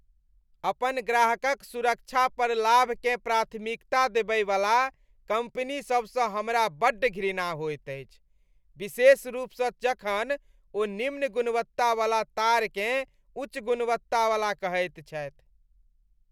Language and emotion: Maithili, disgusted